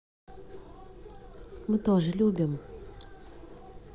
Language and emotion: Russian, neutral